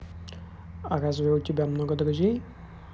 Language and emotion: Russian, neutral